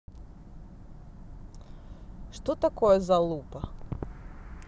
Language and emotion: Russian, neutral